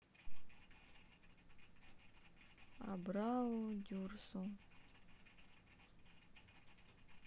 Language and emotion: Russian, sad